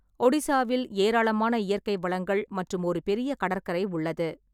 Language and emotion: Tamil, neutral